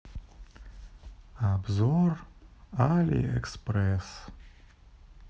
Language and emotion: Russian, sad